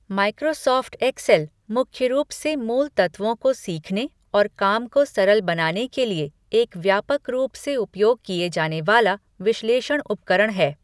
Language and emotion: Hindi, neutral